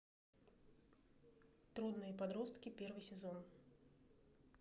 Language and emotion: Russian, neutral